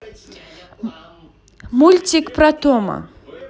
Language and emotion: Russian, positive